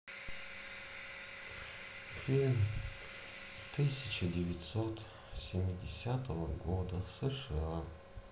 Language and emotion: Russian, sad